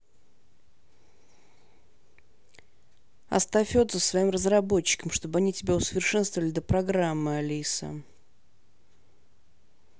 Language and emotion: Russian, angry